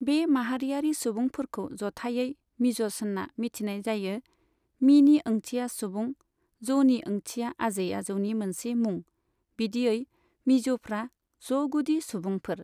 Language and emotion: Bodo, neutral